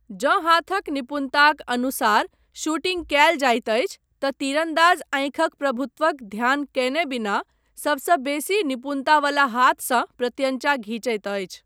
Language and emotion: Maithili, neutral